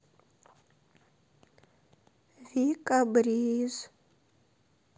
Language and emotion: Russian, sad